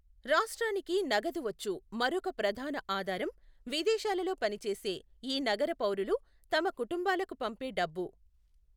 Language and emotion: Telugu, neutral